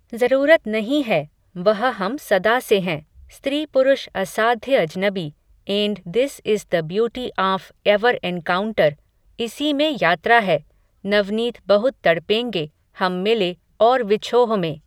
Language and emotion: Hindi, neutral